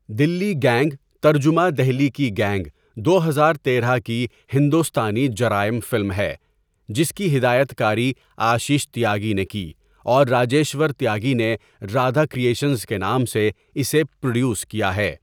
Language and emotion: Urdu, neutral